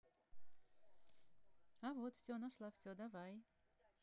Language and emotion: Russian, positive